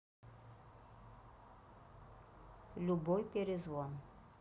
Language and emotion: Russian, neutral